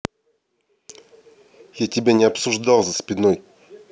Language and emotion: Russian, angry